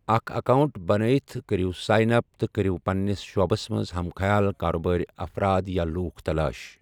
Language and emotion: Kashmiri, neutral